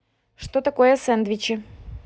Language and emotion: Russian, neutral